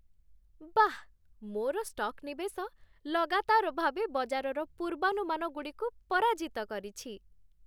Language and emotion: Odia, happy